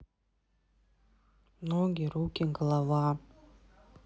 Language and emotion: Russian, neutral